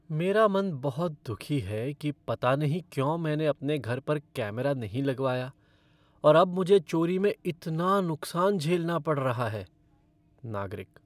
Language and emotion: Hindi, sad